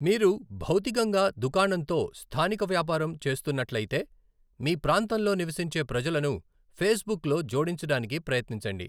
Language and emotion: Telugu, neutral